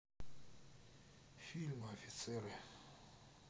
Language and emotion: Russian, sad